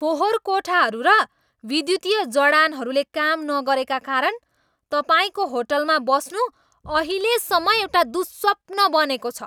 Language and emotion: Nepali, angry